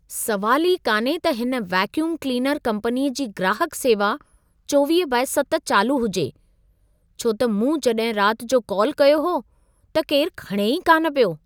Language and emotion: Sindhi, surprised